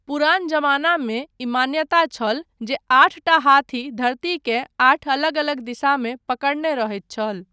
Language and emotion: Maithili, neutral